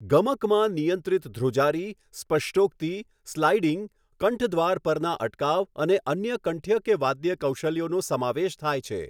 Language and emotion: Gujarati, neutral